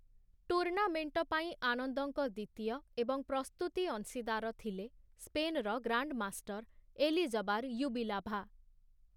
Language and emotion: Odia, neutral